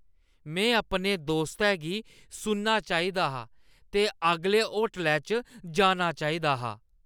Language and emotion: Dogri, disgusted